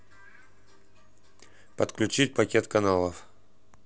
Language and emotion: Russian, neutral